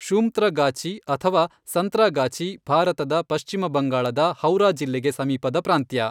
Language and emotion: Kannada, neutral